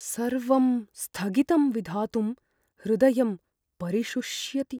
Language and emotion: Sanskrit, fearful